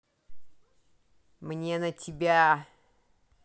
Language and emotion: Russian, angry